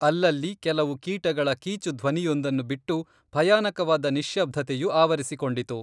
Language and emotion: Kannada, neutral